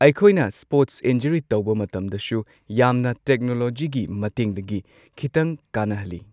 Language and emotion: Manipuri, neutral